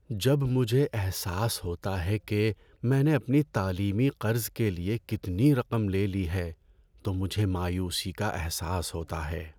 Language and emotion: Urdu, sad